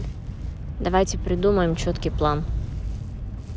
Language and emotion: Russian, neutral